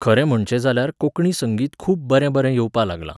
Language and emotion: Goan Konkani, neutral